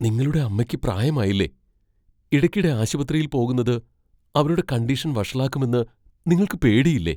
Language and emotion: Malayalam, fearful